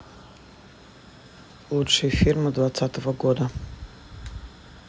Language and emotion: Russian, neutral